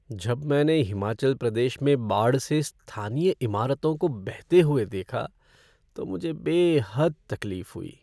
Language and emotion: Hindi, sad